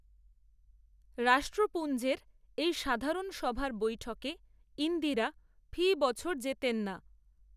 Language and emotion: Bengali, neutral